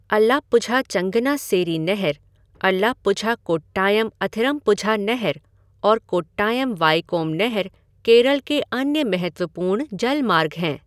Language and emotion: Hindi, neutral